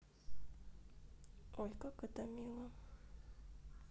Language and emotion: Russian, sad